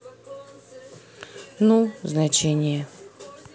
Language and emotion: Russian, neutral